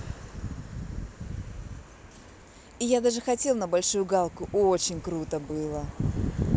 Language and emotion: Russian, positive